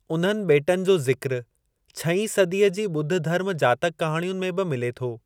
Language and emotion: Sindhi, neutral